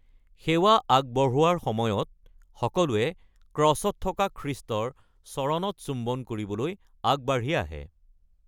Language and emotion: Assamese, neutral